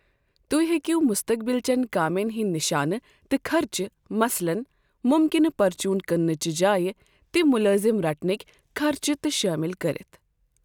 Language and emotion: Kashmiri, neutral